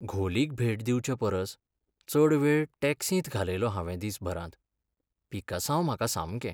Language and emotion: Goan Konkani, sad